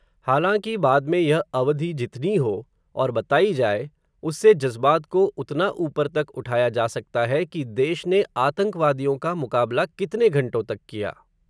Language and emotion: Hindi, neutral